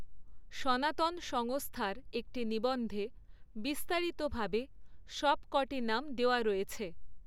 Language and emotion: Bengali, neutral